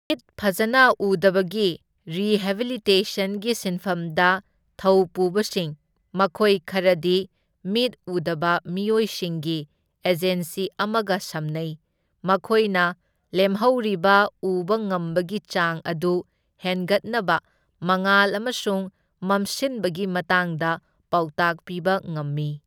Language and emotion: Manipuri, neutral